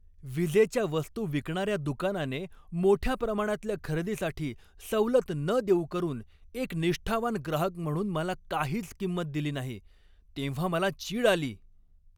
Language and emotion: Marathi, angry